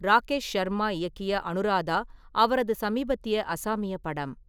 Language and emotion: Tamil, neutral